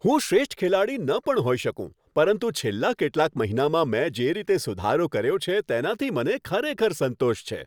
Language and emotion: Gujarati, happy